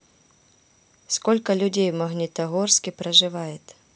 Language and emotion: Russian, neutral